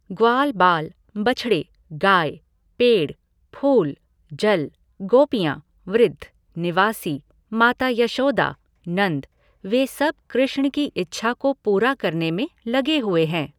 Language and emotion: Hindi, neutral